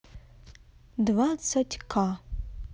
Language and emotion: Russian, neutral